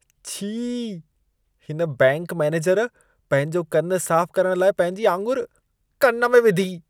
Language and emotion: Sindhi, disgusted